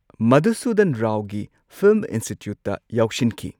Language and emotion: Manipuri, neutral